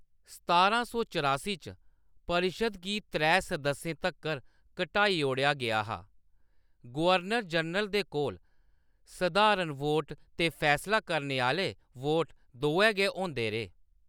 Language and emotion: Dogri, neutral